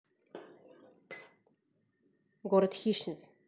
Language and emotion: Russian, neutral